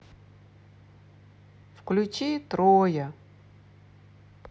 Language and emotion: Russian, sad